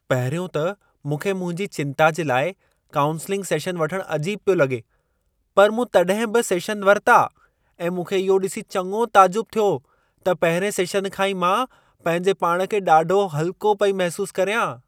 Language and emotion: Sindhi, surprised